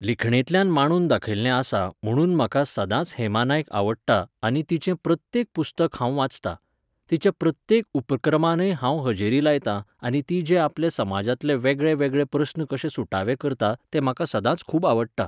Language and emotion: Goan Konkani, neutral